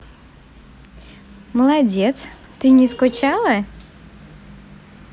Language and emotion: Russian, positive